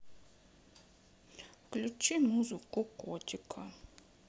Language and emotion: Russian, sad